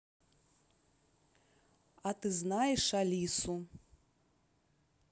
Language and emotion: Russian, neutral